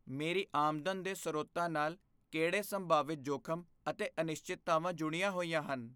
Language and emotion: Punjabi, fearful